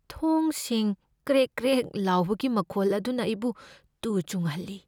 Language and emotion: Manipuri, fearful